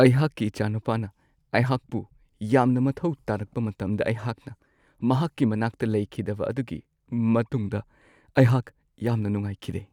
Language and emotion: Manipuri, sad